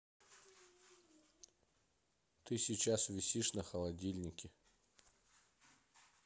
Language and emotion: Russian, neutral